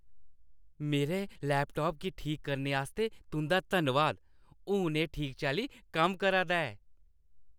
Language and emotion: Dogri, happy